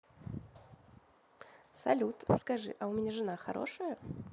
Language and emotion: Russian, positive